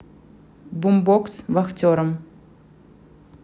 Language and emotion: Russian, neutral